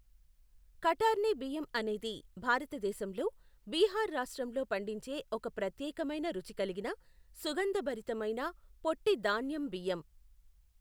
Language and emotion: Telugu, neutral